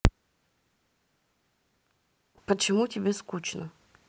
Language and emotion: Russian, neutral